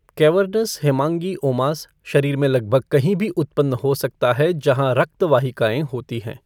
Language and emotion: Hindi, neutral